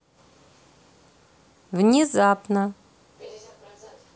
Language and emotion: Russian, neutral